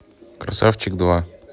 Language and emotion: Russian, neutral